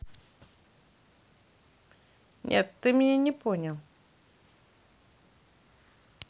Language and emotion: Russian, neutral